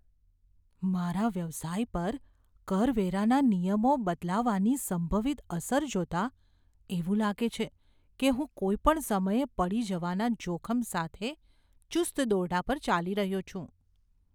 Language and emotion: Gujarati, fearful